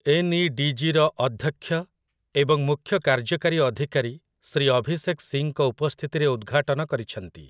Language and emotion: Odia, neutral